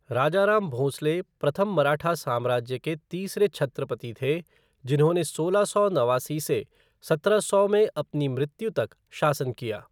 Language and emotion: Hindi, neutral